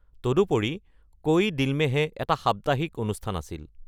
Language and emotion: Assamese, neutral